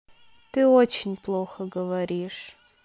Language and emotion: Russian, sad